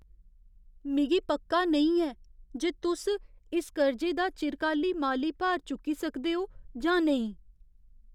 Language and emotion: Dogri, fearful